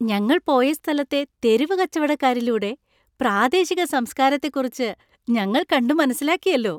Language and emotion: Malayalam, happy